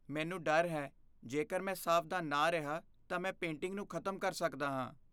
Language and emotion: Punjabi, fearful